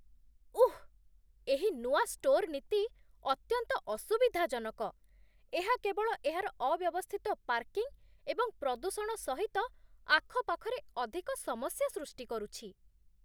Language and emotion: Odia, disgusted